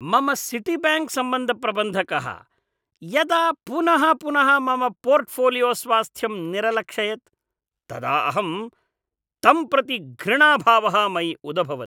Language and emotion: Sanskrit, disgusted